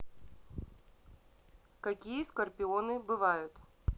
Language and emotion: Russian, neutral